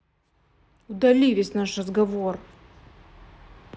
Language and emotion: Russian, angry